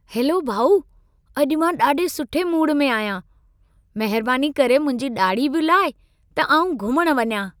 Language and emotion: Sindhi, happy